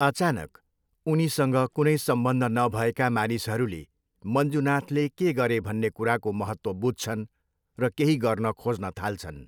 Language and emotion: Nepali, neutral